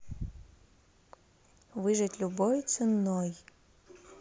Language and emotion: Russian, neutral